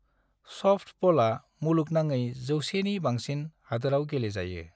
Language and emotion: Bodo, neutral